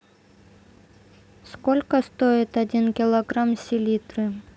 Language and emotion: Russian, neutral